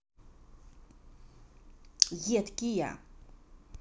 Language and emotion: Russian, neutral